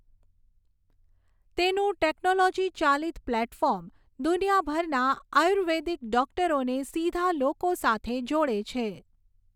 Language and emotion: Gujarati, neutral